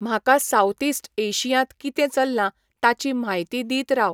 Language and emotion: Goan Konkani, neutral